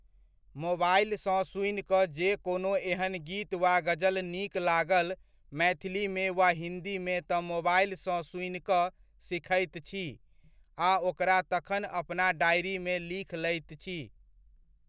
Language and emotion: Maithili, neutral